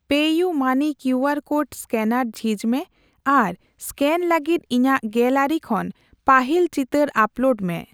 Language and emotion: Santali, neutral